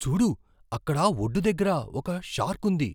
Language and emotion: Telugu, surprised